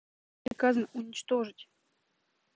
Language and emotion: Russian, neutral